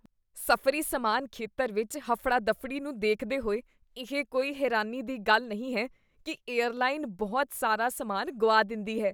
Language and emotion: Punjabi, disgusted